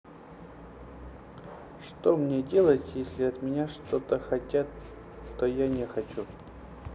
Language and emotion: Russian, sad